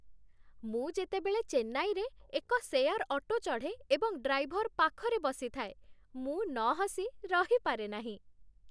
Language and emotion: Odia, happy